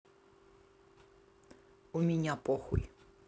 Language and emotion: Russian, neutral